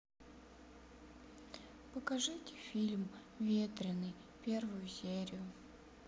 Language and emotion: Russian, sad